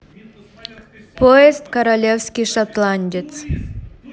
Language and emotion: Russian, neutral